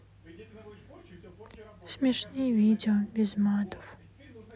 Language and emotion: Russian, sad